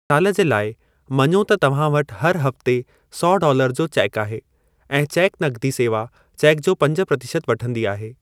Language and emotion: Sindhi, neutral